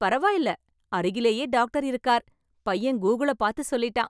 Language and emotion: Tamil, happy